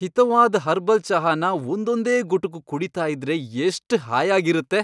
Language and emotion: Kannada, happy